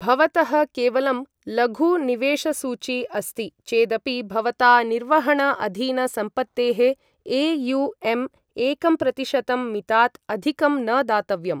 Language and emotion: Sanskrit, neutral